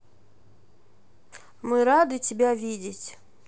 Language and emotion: Russian, neutral